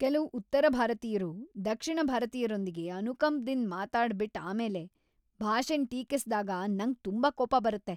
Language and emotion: Kannada, angry